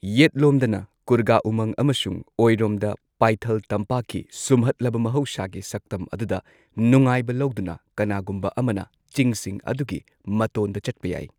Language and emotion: Manipuri, neutral